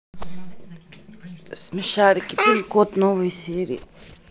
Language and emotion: Russian, neutral